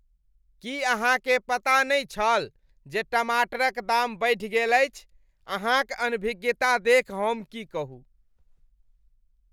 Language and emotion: Maithili, disgusted